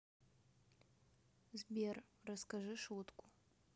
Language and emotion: Russian, neutral